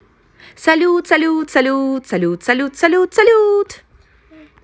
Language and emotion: Russian, positive